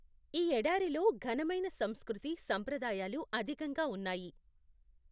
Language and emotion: Telugu, neutral